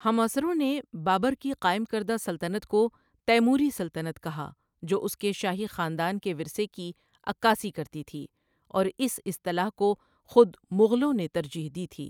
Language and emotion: Urdu, neutral